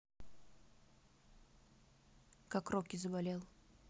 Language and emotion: Russian, neutral